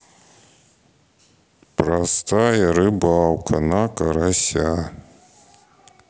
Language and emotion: Russian, sad